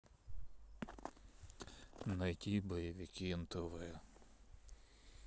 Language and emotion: Russian, sad